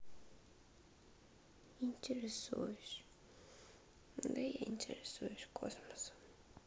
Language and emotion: Russian, sad